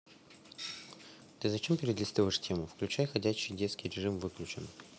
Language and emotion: Russian, neutral